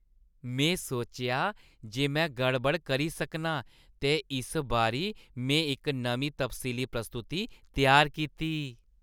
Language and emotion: Dogri, happy